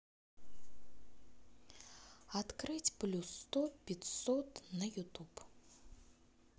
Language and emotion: Russian, neutral